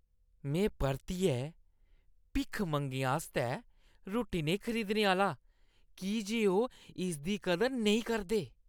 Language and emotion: Dogri, disgusted